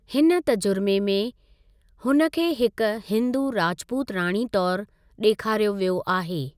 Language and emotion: Sindhi, neutral